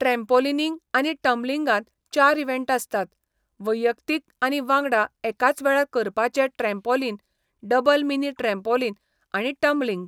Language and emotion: Goan Konkani, neutral